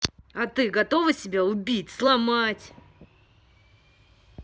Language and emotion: Russian, angry